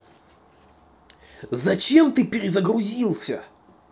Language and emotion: Russian, angry